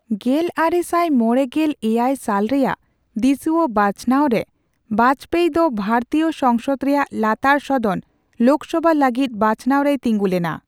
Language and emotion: Santali, neutral